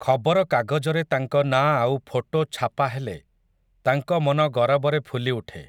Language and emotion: Odia, neutral